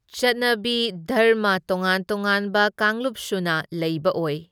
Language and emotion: Manipuri, neutral